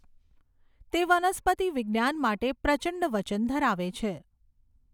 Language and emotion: Gujarati, neutral